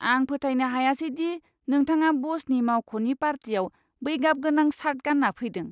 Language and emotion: Bodo, disgusted